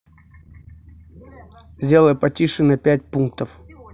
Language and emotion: Russian, neutral